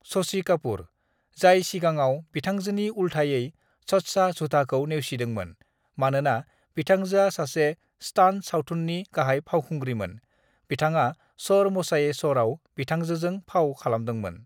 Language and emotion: Bodo, neutral